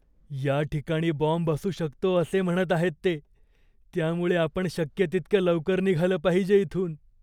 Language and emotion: Marathi, fearful